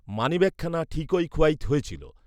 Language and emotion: Bengali, neutral